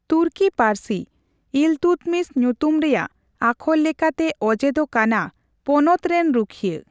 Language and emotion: Santali, neutral